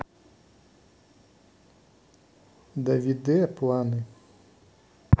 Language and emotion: Russian, neutral